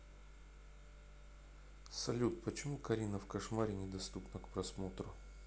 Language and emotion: Russian, neutral